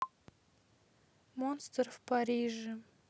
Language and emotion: Russian, sad